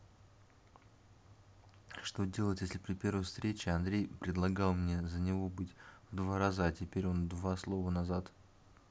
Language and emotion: Russian, neutral